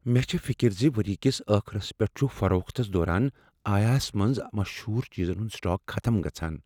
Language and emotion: Kashmiri, fearful